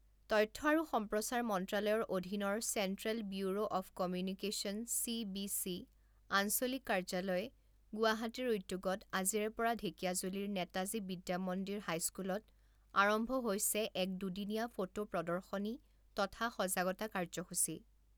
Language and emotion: Assamese, neutral